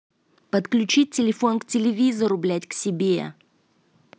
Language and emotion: Russian, angry